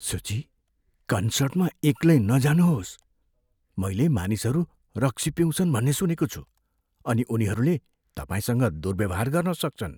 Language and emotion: Nepali, fearful